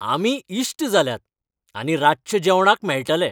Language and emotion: Goan Konkani, happy